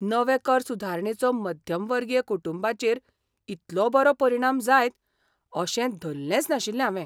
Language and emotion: Goan Konkani, surprised